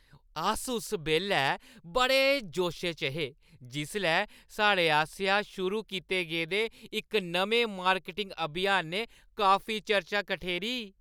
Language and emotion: Dogri, happy